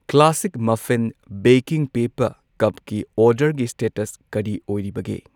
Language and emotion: Manipuri, neutral